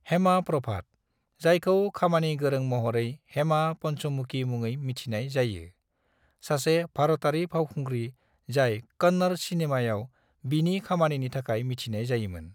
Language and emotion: Bodo, neutral